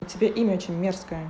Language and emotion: Russian, angry